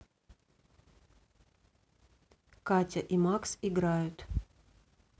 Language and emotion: Russian, neutral